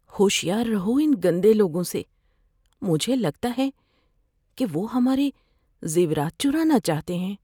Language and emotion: Urdu, fearful